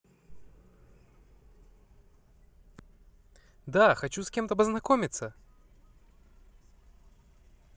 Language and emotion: Russian, positive